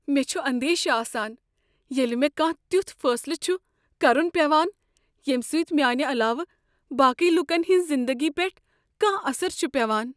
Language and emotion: Kashmiri, fearful